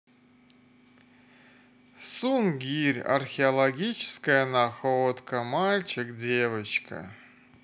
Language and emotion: Russian, sad